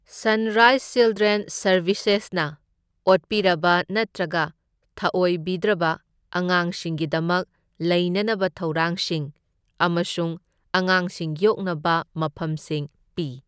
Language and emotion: Manipuri, neutral